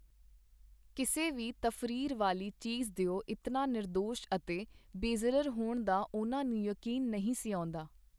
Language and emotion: Punjabi, neutral